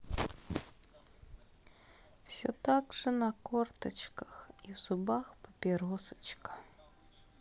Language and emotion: Russian, sad